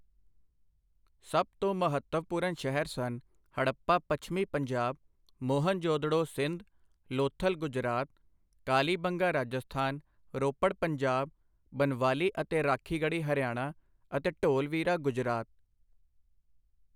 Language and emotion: Punjabi, neutral